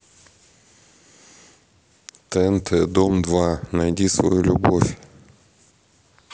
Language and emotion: Russian, neutral